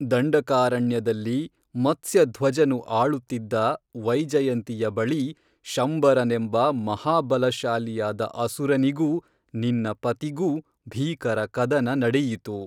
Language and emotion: Kannada, neutral